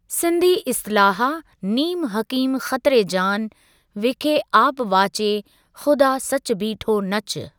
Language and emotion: Sindhi, neutral